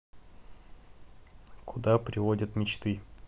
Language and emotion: Russian, neutral